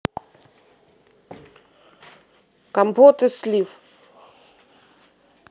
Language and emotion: Russian, neutral